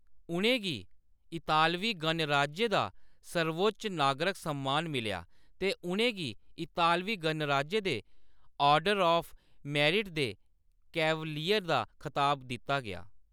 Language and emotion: Dogri, neutral